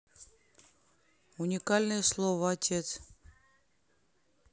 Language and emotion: Russian, neutral